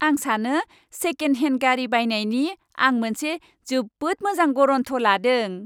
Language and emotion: Bodo, happy